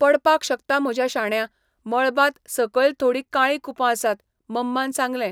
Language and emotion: Goan Konkani, neutral